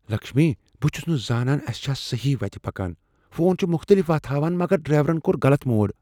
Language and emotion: Kashmiri, fearful